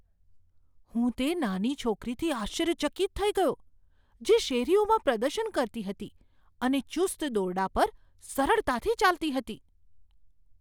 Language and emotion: Gujarati, surprised